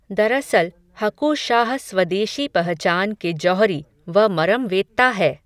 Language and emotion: Hindi, neutral